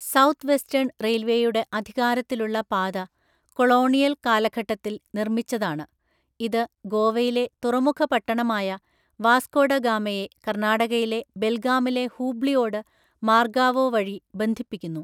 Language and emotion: Malayalam, neutral